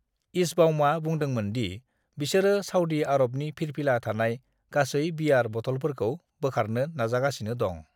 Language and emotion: Bodo, neutral